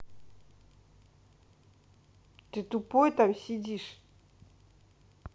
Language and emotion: Russian, angry